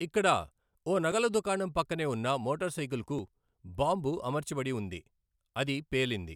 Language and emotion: Telugu, neutral